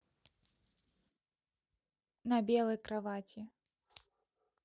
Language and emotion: Russian, neutral